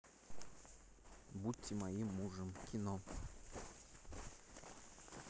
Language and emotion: Russian, neutral